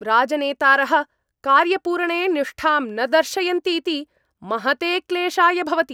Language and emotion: Sanskrit, angry